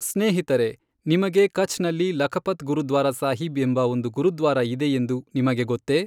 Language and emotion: Kannada, neutral